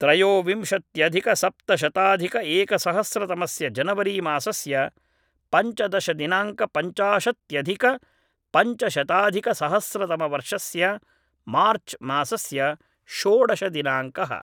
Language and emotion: Sanskrit, neutral